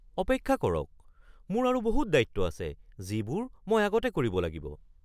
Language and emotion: Assamese, surprised